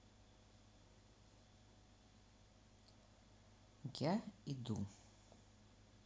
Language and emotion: Russian, neutral